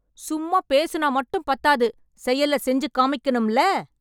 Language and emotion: Tamil, angry